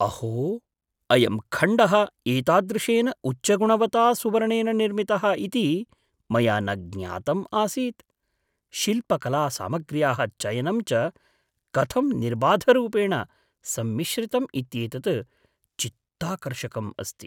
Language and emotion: Sanskrit, surprised